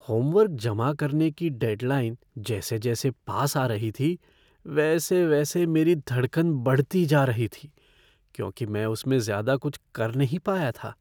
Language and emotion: Hindi, fearful